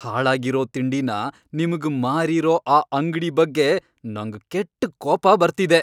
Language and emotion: Kannada, angry